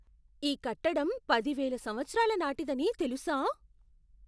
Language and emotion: Telugu, surprised